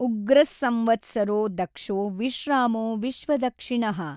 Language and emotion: Kannada, neutral